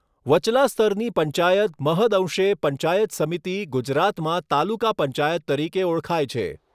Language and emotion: Gujarati, neutral